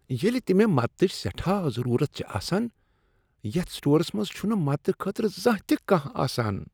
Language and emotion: Kashmiri, disgusted